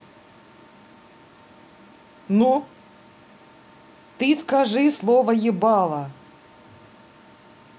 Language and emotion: Russian, angry